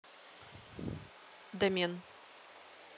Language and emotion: Russian, neutral